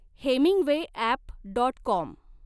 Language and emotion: Marathi, neutral